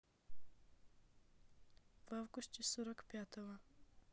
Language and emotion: Russian, neutral